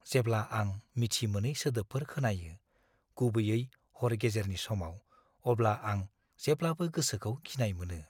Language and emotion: Bodo, fearful